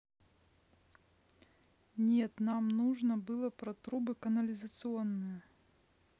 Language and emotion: Russian, neutral